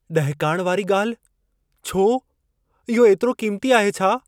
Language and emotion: Sindhi, fearful